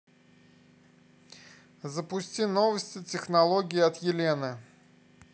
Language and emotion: Russian, neutral